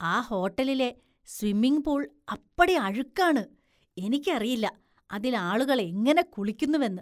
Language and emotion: Malayalam, disgusted